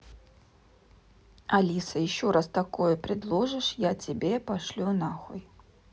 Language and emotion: Russian, neutral